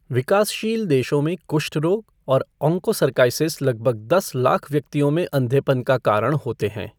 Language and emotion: Hindi, neutral